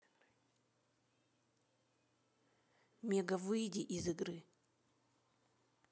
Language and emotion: Russian, neutral